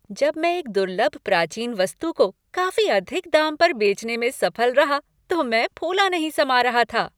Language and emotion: Hindi, happy